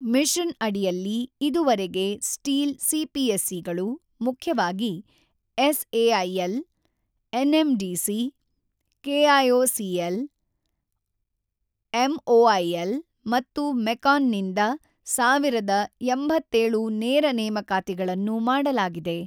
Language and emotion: Kannada, neutral